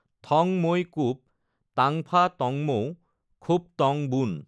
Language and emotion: Assamese, neutral